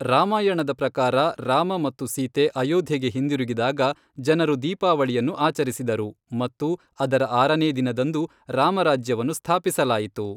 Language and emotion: Kannada, neutral